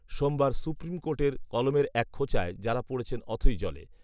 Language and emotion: Bengali, neutral